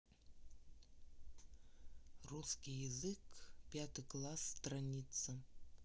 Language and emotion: Russian, neutral